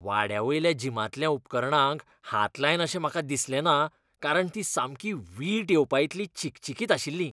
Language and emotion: Goan Konkani, disgusted